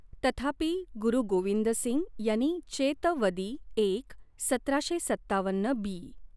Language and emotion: Marathi, neutral